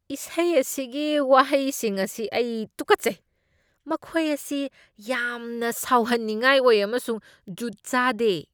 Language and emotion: Manipuri, disgusted